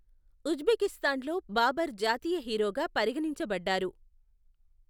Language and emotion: Telugu, neutral